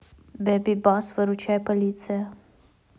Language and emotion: Russian, neutral